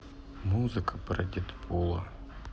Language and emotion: Russian, sad